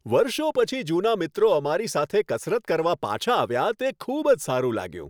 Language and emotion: Gujarati, happy